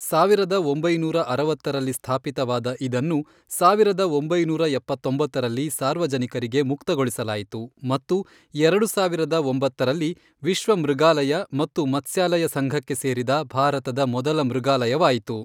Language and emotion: Kannada, neutral